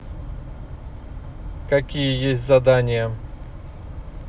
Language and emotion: Russian, neutral